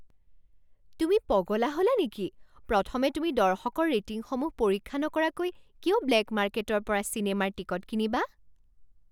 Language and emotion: Assamese, surprised